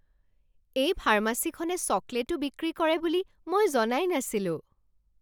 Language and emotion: Assamese, surprised